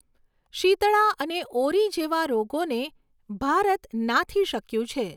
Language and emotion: Gujarati, neutral